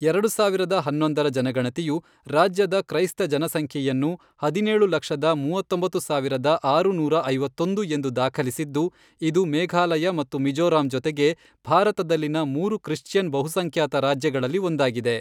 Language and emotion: Kannada, neutral